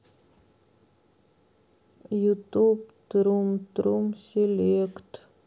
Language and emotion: Russian, sad